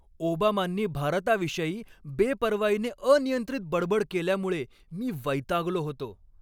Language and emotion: Marathi, angry